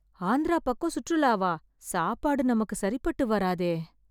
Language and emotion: Tamil, sad